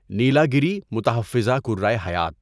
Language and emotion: Urdu, neutral